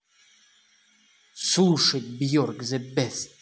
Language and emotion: Russian, angry